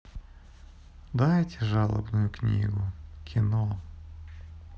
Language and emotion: Russian, sad